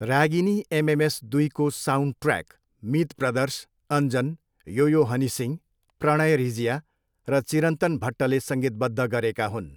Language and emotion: Nepali, neutral